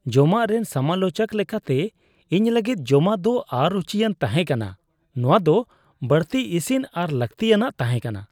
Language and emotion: Santali, disgusted